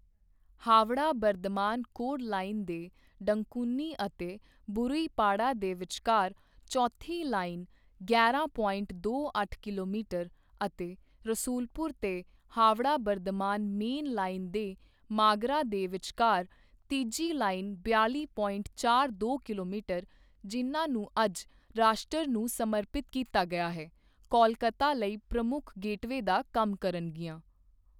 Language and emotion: Punjabi, neutral